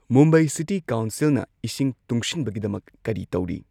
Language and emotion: Manipuri, neutral